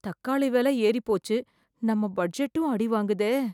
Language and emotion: Tamil, fearful